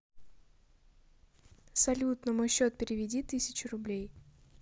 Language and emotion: Russian, neutral